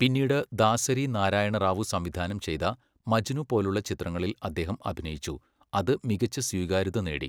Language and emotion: Malayalam, neutral